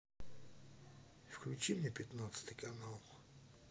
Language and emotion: Russian, neutral